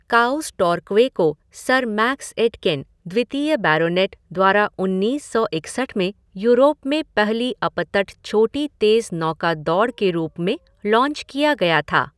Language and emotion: Hindi, neutral